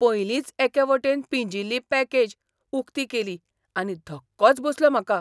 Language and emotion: Goan Konkani, surprised